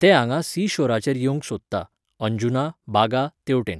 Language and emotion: Goan Konkani, neutral